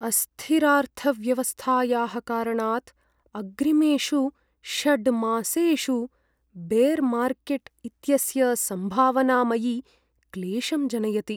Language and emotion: Sanskrit, sad